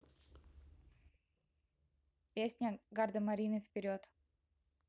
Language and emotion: Russian, neutral